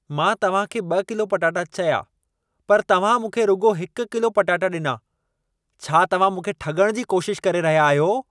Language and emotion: Sindhi, angry